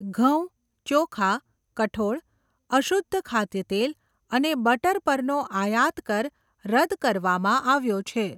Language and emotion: Gujarati, neutral